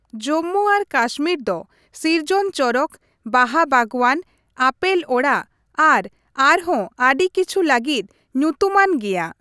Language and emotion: Santali, neutral